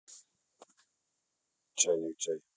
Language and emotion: Russian, neutral